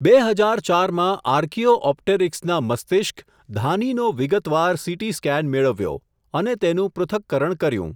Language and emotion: Gujarati, neutral